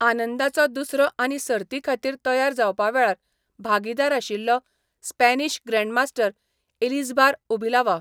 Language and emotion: Goan Konkani, neutral